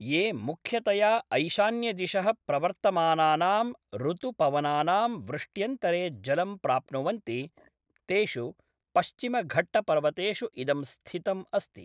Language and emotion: Sanskrit, neutral